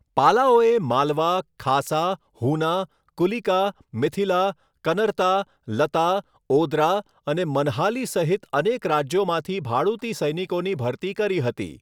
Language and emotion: Gujarati, neutral